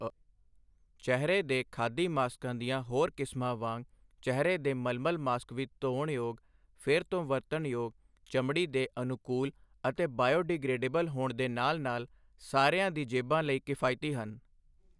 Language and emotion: Punjabi, neutral